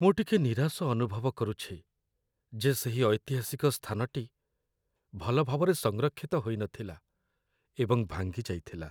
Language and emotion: Odia, sad